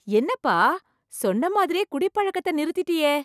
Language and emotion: Tamil, surprised